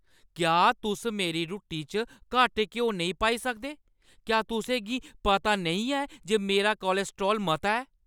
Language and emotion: Dogri, angry